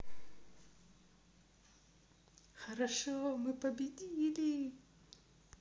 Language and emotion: Russian, positive